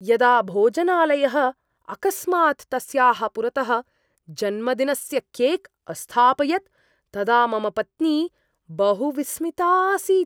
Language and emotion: Sanskrit, surprised